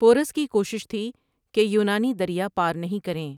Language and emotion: Urdu, neutral